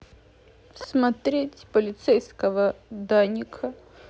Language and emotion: Russian, sad